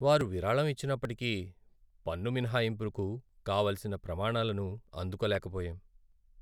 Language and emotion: Telugu, sad